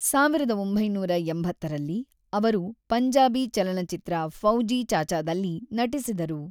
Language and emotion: Kannada, neutral